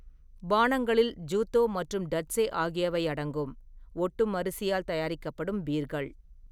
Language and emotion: Tamil, neutral